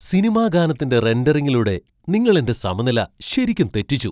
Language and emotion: Malayalam, surprised